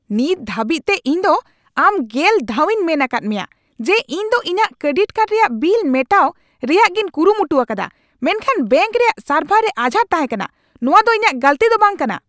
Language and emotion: Santali, angry